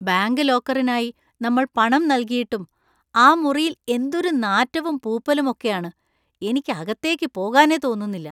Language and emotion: Malayalam, disgusted